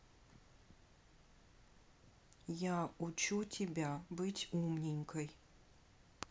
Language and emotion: Russian, neutral